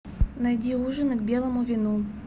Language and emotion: Russian, neutral